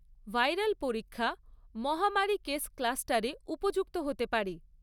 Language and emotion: Bengali, neutral